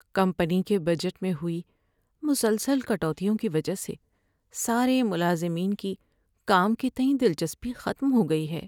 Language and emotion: Urdu, sad